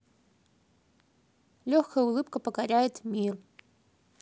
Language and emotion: Russian, neutral